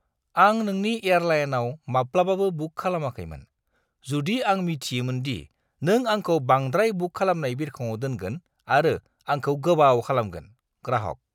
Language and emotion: Bodo, disgusted